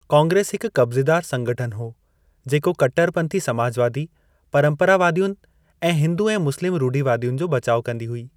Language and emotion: Sindhi, neutral